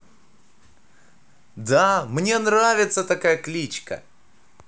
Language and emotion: Russian, positive